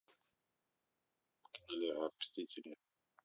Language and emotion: Russian, neutral